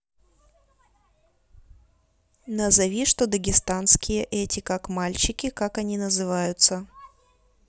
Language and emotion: Russian, neutral